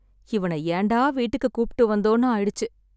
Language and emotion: Tamil, sad